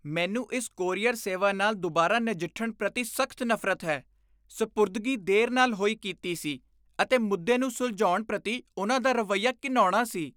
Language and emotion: Punjabi, disgusted